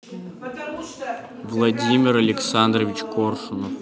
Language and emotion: Russian, neutral